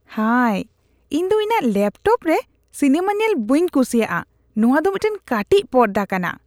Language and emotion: Santali, disgusted